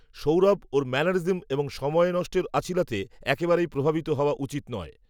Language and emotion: Bengali, neutral